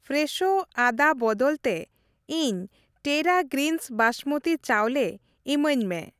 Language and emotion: Santali, neutral